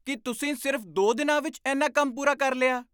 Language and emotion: Punjabi, surprised